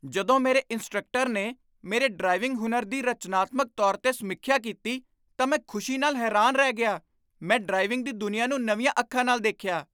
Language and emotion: Punjabi, surprised